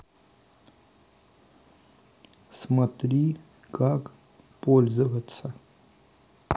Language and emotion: Russian, neutral